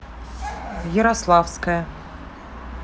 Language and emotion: Russian, neutral